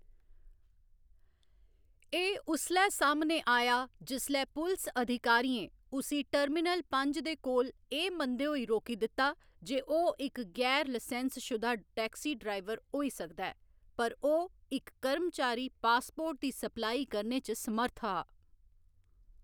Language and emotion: Dogri, neutral